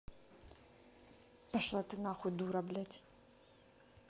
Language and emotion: Russian, angry